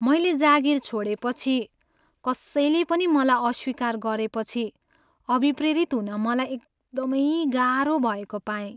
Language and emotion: Nepali, sad